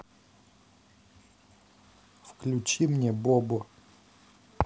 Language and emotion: Russian, neutral